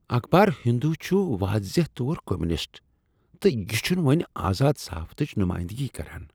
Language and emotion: Kashmiri, disgusted